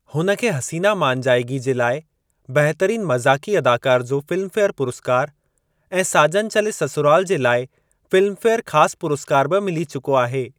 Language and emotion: Sindhi, neutral